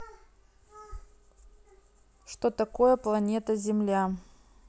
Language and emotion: Russian, neutral